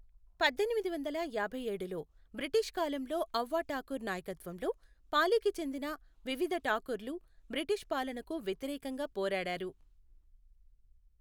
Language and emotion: Telugu, neutral